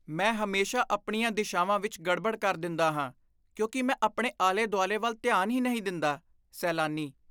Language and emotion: Punjabi, disgusted